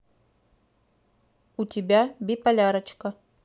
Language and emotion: Russian, neutral